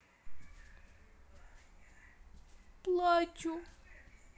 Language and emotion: Russian, sad